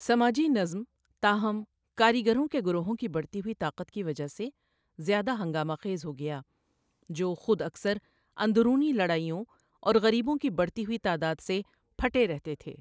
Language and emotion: Urdu, neutral